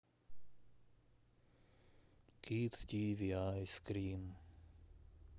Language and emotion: Russian, sad